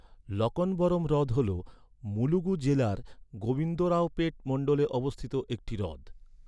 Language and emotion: Bengali, neutral